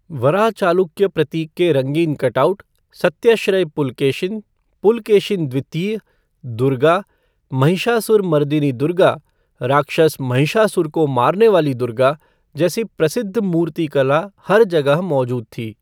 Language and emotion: Hindi, neutral